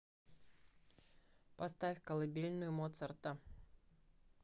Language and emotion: Russian, neutral